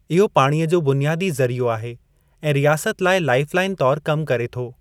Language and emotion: Sindhi, neutral